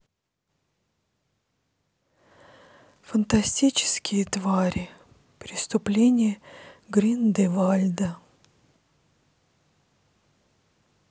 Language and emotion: Russian, sad